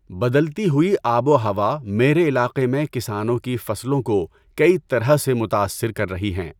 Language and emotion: Urdu, neutral